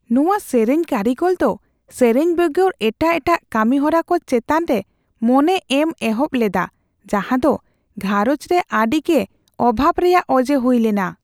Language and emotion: Santali, fearful